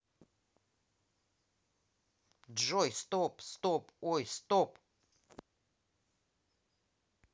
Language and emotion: Russian, neutral